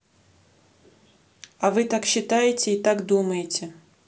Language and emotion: Russian, neutral